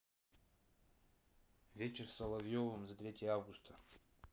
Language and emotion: Russian, neutral